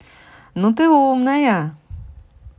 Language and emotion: Russian, positive